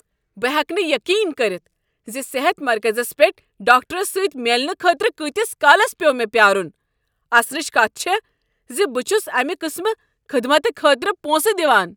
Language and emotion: Kashmiri, angry